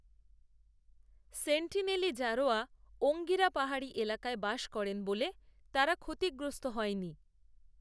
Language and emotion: Bengali, neutral